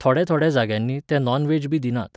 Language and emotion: Goan Konkani, neutral